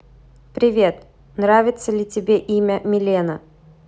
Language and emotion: Russian, neutral